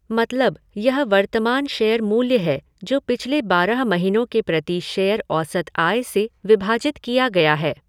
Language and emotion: Hindi, neutral